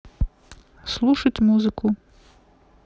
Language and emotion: Russian, neutral